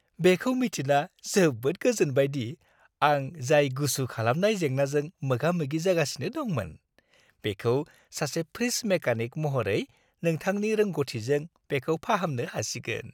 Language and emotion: Bodo, happy